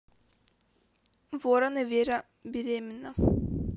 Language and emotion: Russian, neutral